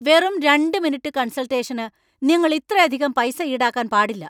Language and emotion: Malayalam, angry